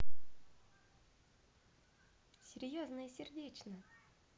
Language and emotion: Russian, positive